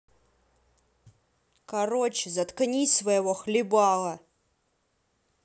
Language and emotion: Russian, angry